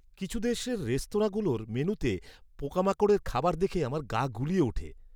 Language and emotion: Bengali, disgusted